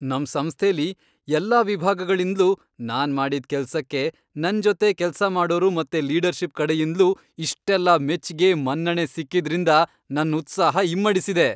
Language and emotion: Kannada, happy